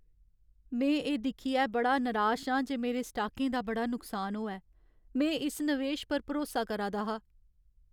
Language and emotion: Dogri, sad